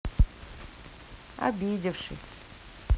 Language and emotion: Russian, sad